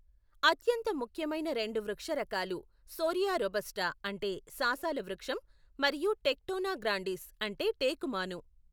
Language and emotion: Telugu, neutral